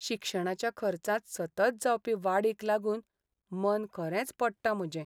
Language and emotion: Goan Konkani, sad